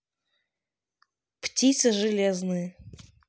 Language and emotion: Russian, neutral